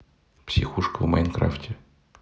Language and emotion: Russian, neutral